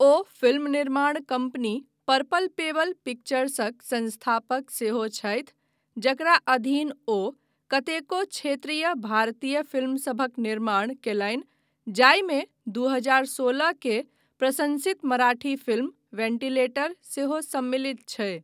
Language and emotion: Maithili, neutral